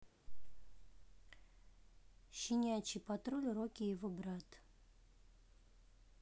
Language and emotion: Russian, neutral